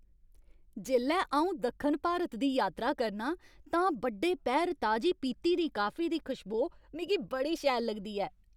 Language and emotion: Dogri, happy